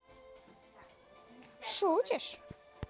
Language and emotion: Russian, neutral